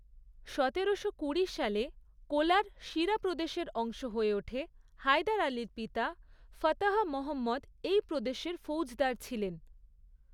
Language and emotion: Bengali, neutral